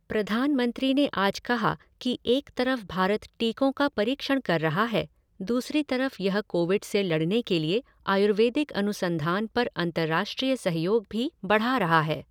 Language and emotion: Hindi, neutral